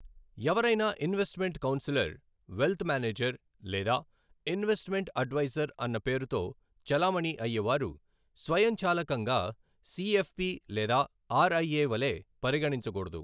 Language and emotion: Telugu, neutral